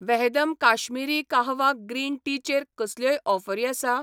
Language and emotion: Goan Konkani, neutral